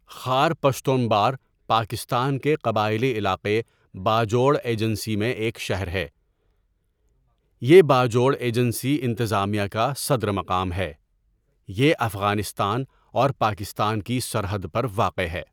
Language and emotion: Urdu, neutral